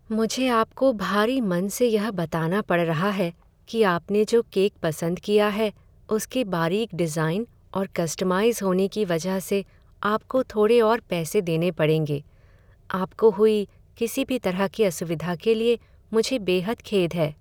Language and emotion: Hindi, sad